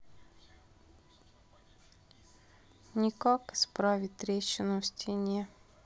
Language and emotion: Russian, sad